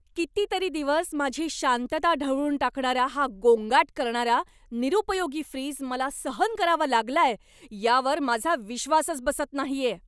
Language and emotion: Marathi, angry